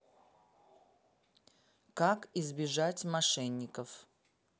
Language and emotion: Russian, neutral